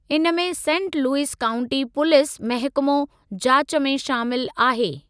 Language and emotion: Sindhi, neutral